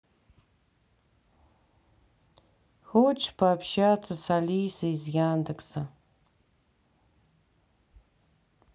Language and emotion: Russian, sad